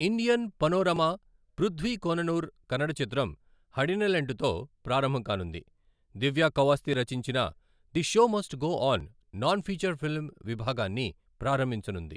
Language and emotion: Telugu, neutral